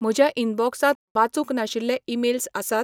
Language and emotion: Goan Konkani, neutral